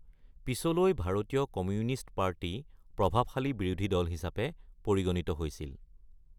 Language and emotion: Assamese, neutral